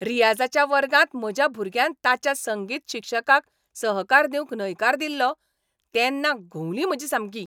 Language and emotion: Goan Konkani, angry